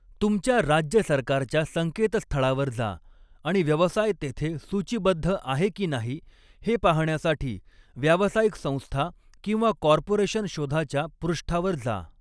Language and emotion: Marathi, neutral